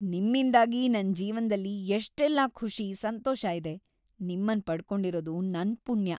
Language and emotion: Kannada, happy